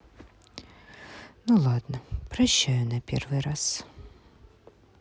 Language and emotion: Russian, sad